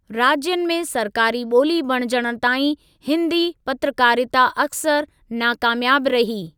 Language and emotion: Sindhi, neutral